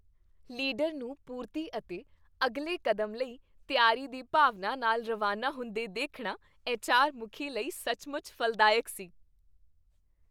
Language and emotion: Punjabi, happy